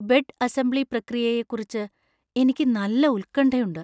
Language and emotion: Malayalam, fearful